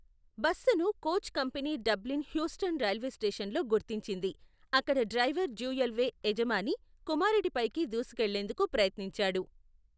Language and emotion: Telugu, neutral